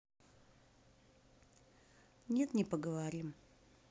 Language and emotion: Russian, neutral